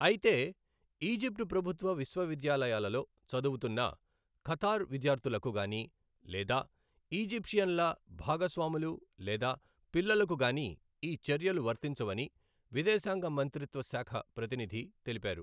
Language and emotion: Telugu, neutral